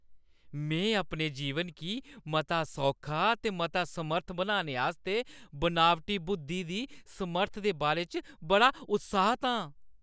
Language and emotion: Dogri, happy